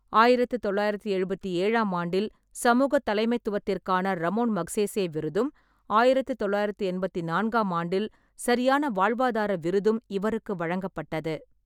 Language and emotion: Tamil, neutral